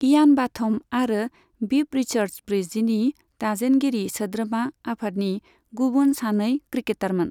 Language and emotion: Bodo, neutral